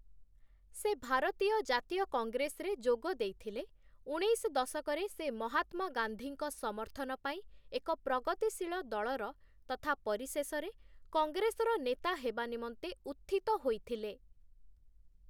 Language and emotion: Odia, neutral